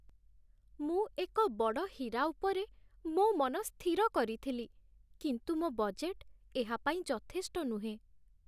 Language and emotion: Odia, sad